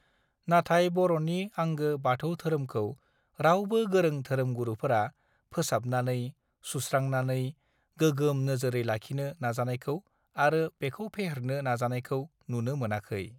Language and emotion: Bodo, neutral